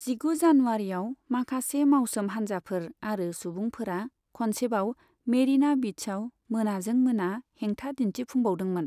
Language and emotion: Bodo, neutral